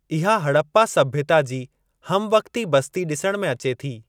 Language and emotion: Sindhi, neutral